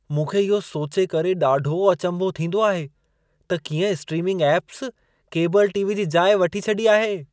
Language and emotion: Sindhi, surprised